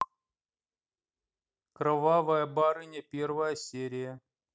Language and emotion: Russian, neutral